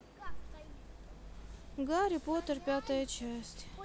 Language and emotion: Russian, sad